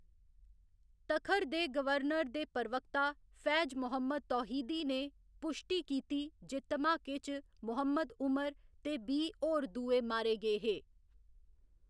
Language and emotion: Dogri, neutral